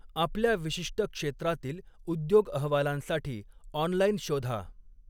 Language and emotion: Marathi, neutral